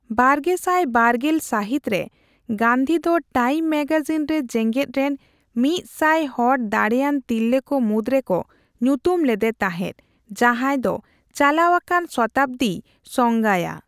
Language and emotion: Santali, neutral